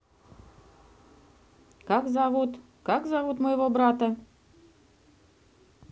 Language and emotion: Russian, neutral